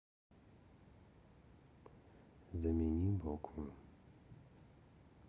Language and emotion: Russian, neutral